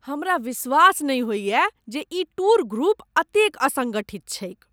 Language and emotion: Maithili, disgusted